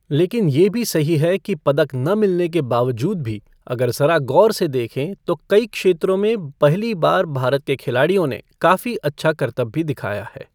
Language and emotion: Hindi, neutral